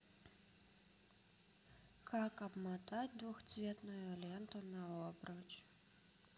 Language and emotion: Russian, neutral